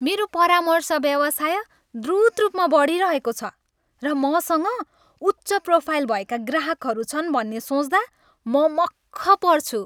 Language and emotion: Nepali, happy